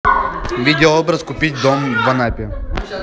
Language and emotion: Russian, neutral